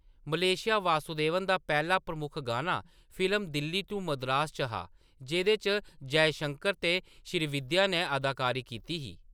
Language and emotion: Dogri, neutral